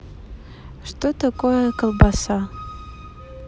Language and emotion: Russian, neutral